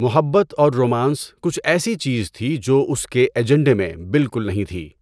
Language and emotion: Urdu, neutral